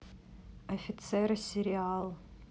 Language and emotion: Russian, neutral